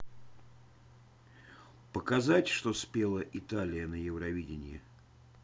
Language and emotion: Russian, neutral